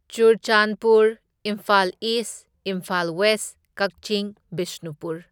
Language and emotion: Manipuri, neutral